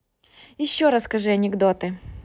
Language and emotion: Russian, positive